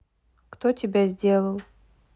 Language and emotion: Russian, neutral